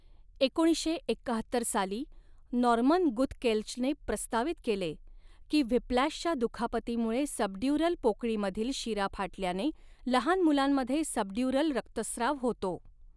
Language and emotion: Marathi, neutral